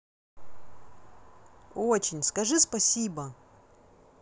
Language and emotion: Russian, neutral